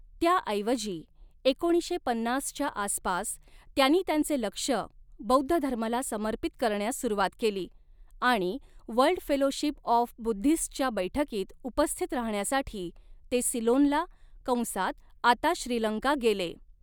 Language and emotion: Marathi, neutral